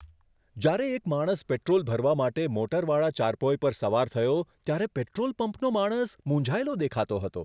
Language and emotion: Gujarati, surprised